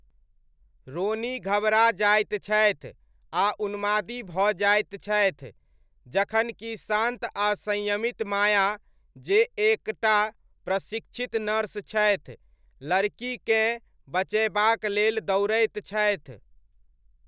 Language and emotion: Maithili, neutral